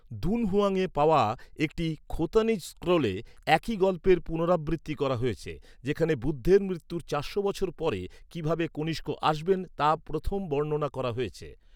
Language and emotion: Bengali, neutral